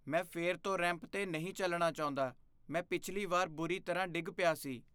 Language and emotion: Punjabi, fearful